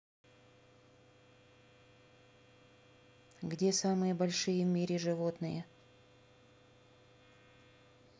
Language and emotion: Russian, neutral